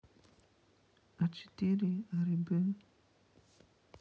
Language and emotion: Russian, sad